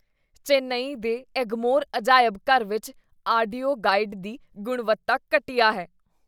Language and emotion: Punjabi, disgusted